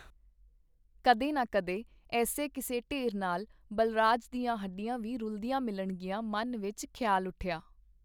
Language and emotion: Punjabi, neutral